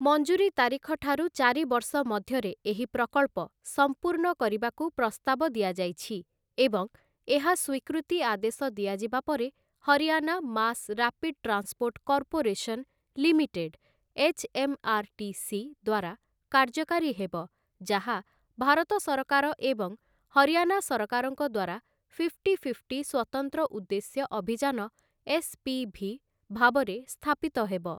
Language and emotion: Odia, neutral